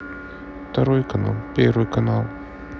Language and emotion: Russian, neutral